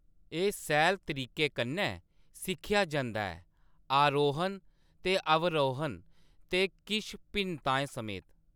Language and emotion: Dogri, neutral